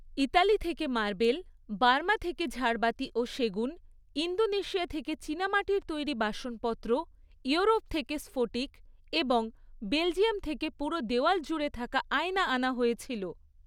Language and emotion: Bengali, neutral